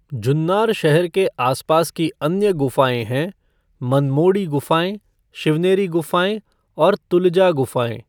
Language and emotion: Hindi, neutral